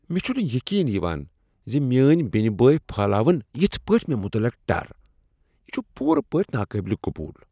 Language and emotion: Kashmiri, disgusted